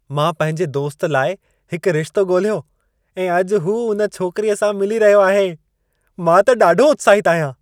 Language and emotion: Sindhi, happy